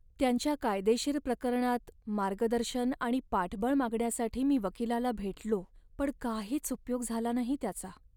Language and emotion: Marathi, sad